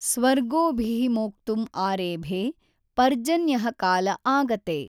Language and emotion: Kannada, neutral